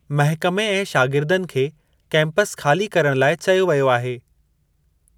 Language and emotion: Sindhi, neutral